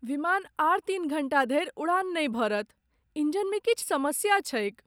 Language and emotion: Maithili, sad